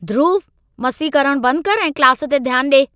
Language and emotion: Sindhi, angry